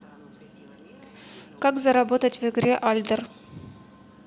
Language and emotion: Russian, neutral